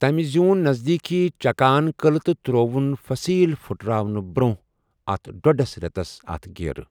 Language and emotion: Kashmiri, neutral